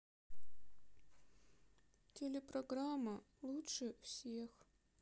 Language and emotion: Russian, sad